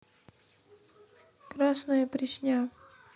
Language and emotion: Russian, neutral